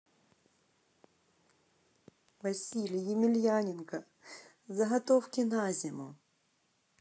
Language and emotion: Russian, sad